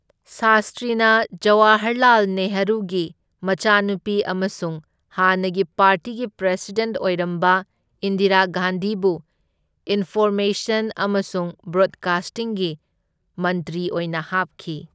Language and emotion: Manipuri, neutral